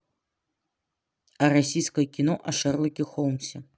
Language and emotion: Russian, neutral